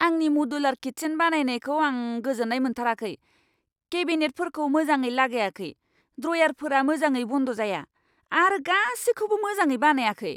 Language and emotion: Bodo, angry